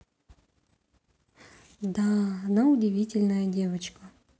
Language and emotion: Russian, neutral